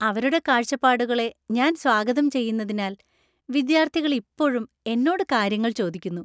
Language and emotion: Malayalam, happy